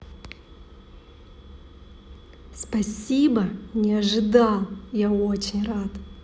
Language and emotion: Russian, positive